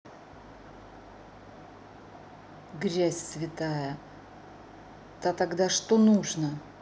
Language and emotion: Russian, angry